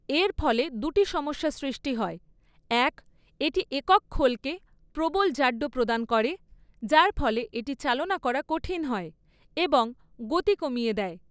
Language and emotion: Bengali, neutral